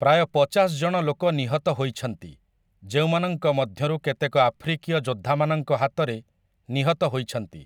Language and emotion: Odia, neutral